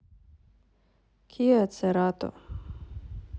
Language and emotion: Russian, neutral